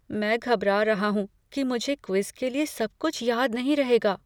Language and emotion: Hindi, fearful